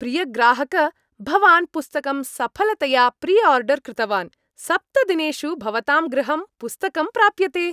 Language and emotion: Sanskrit, happy